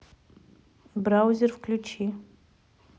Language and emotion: Russian, neutral